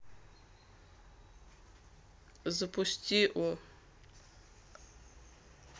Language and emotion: Russian, neutral